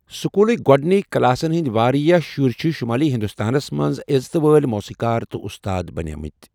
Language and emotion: Kashmiri, neutral